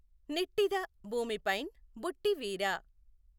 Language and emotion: Telugu, neutral